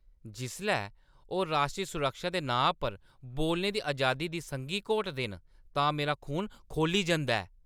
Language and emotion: Dogri, angry